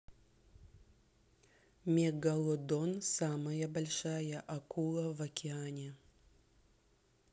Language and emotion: Russian, neutral